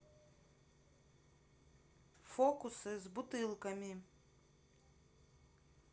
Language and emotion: Russian, neutral